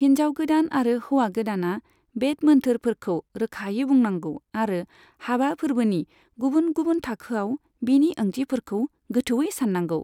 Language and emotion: Bodo, neutral